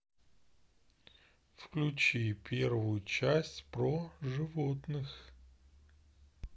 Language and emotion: Russian, neutral